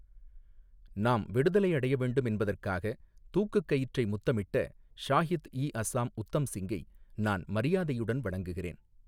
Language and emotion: Tamil, neutral